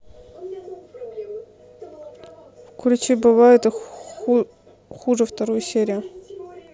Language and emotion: Russian, neutral